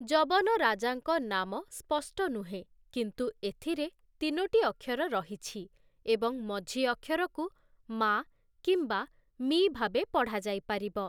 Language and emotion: Odia, neutral